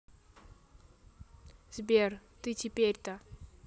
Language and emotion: Russian, neutral